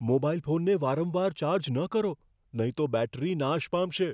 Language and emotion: Gujarati, fearful